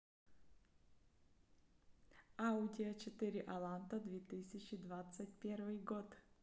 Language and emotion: Russian, neutral